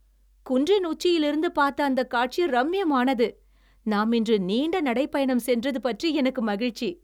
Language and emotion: Tamil, happy